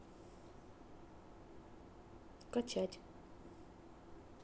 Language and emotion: Russian, neutral